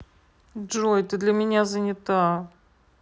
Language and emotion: Russian, sad